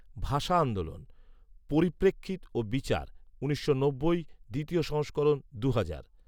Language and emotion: Bengali, neutral